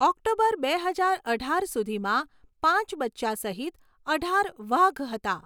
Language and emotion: Gujarati, neutral